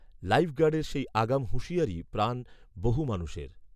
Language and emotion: Bengali, neutral